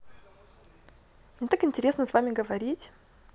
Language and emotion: Russian, positive